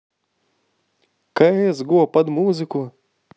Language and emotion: Russian, positive